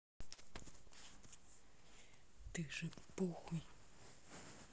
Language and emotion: Russian, angry